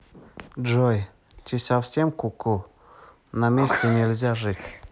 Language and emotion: Russian, neutral